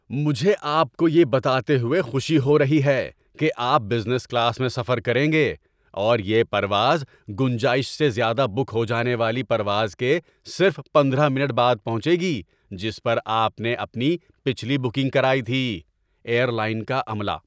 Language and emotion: Urdu, happy